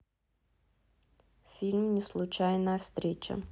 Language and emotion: Russian, neutral